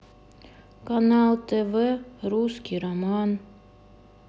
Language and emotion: Russian, sad